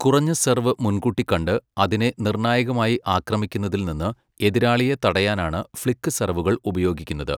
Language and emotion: Malayalam, neutral